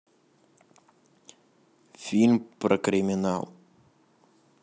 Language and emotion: Russian, neutral